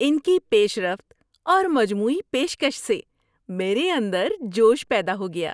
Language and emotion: Urdu, happy